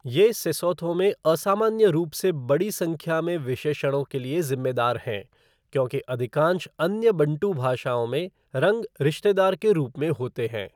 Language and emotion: Hindi, neutral